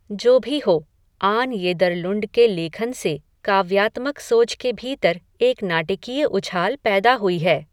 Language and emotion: Hindi, neutral